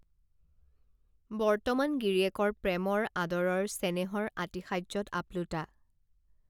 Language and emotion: Assamese, neutral